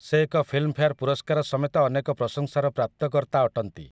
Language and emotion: Odia, neutral